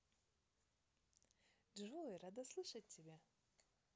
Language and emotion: Russian, positive